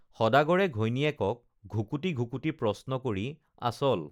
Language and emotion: Assamese, neutral